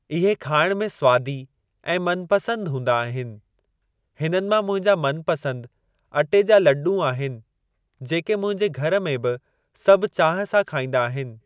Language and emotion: Sindhi, neutral